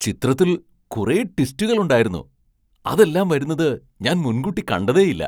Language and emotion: Malayalam, surprised